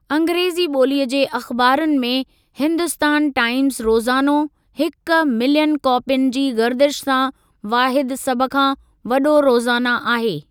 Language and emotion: Sindhi, neutral